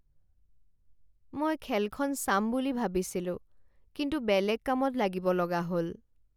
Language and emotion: Assamese, sad